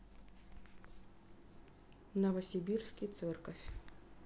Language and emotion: Russian, neutral